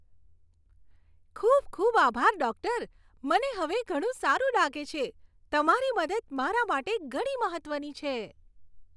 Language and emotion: Gujarati, happy